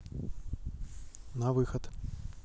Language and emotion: Russian, neutral